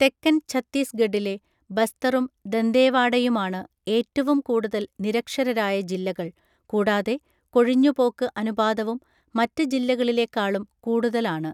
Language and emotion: Malayalam, neutral